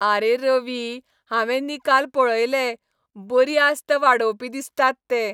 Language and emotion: Goan Konkani, happy